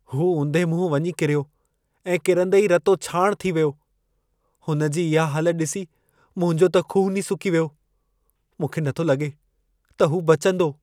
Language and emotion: Sindhi, fearful